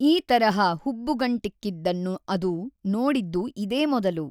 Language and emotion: Kannada, neutral